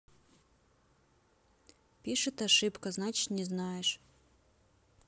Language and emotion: Russian, neutral